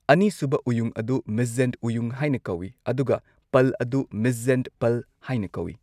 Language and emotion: Manipuri, neutral